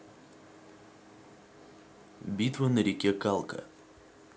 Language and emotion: Russian, neutral